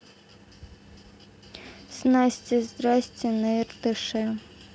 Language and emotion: Russian, neutral